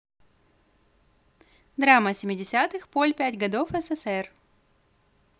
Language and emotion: Russian, positive